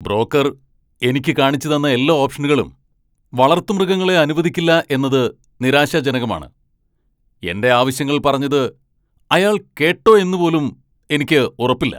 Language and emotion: Malayalam, angry